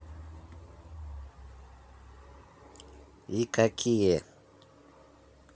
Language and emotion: Russian, neutral